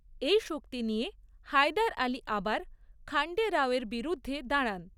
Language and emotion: Bengali, neutral